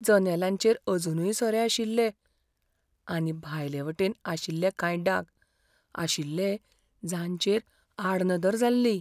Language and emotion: Goan Konkani, fearful